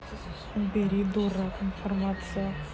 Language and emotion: Russian, angry